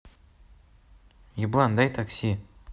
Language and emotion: Russian, neutral